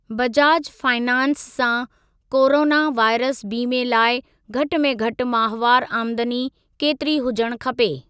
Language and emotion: Sindhi, neutral